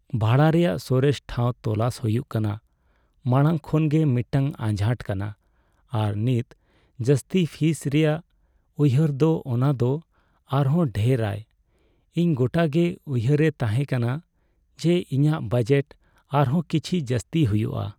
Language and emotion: Santali, sad